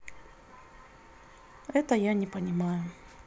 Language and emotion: Russian, neutral